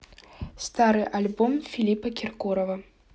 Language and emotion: Russian, neutral